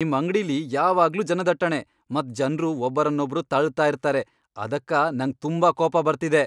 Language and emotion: Kannada, angry